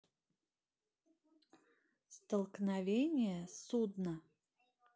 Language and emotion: Russian, neutral